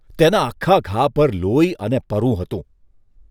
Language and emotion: Gujarati, disgusted